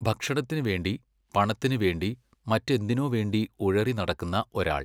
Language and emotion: Malayalam, neutral